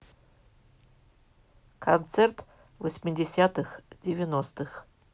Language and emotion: Russian, neutral